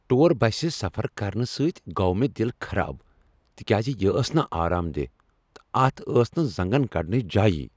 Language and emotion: Kashmiri, angry